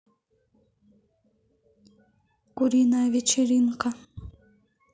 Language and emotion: Russian, neutral